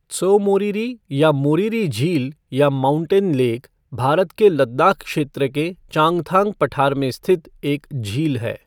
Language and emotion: Hindi, neutral